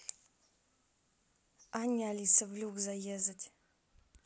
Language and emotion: Russian, neutral